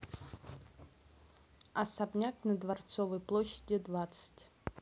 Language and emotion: Russian, neutral